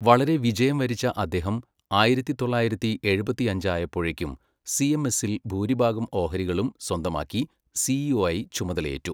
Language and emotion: Malayalam, neutral